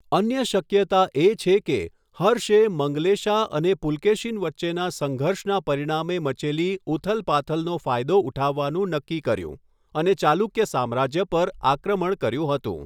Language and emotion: Gujarati, neutral